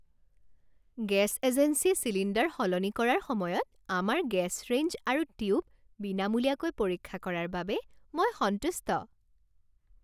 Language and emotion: Assamese, happy